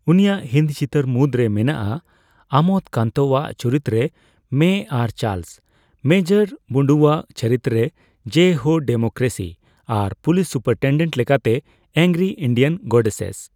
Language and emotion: Santali, neutral